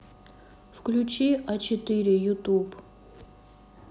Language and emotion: Russian, neutral